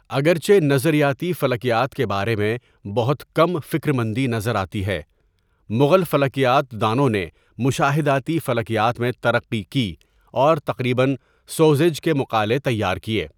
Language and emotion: Urdu, neutral